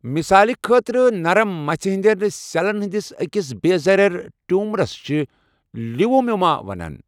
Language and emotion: Kashmiri, neutral